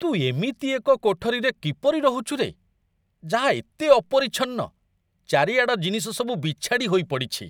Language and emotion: Odia, disgusted